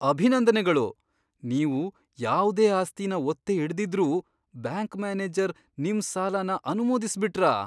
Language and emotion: Kannada, surprised